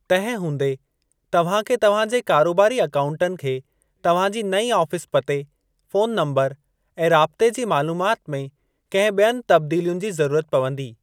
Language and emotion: Sindhi, neutral